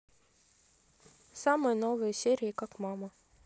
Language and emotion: Russian, neutral